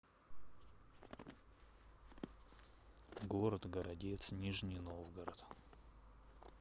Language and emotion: Russian, neutral